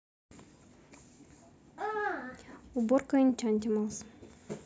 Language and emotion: Russian, neutral